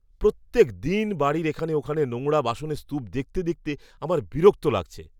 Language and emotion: Bengali, disgusted